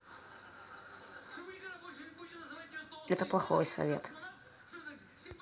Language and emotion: Russian, neutral